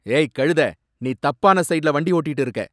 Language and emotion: Tamil, angry